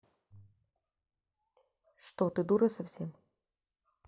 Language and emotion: Russian, neutral